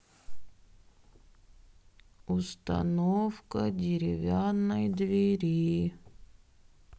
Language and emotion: Russian, sad